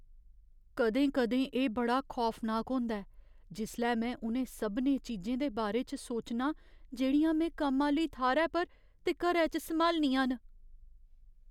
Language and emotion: Dogri, fearful